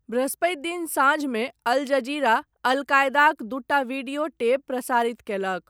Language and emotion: Maithili, neutral